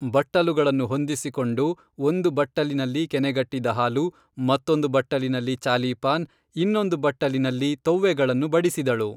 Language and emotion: Kannada, neutral